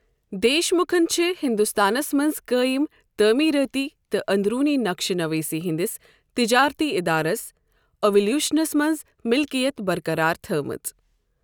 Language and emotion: Kashmiri, neutral